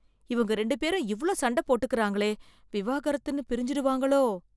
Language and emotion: Tamil, fearful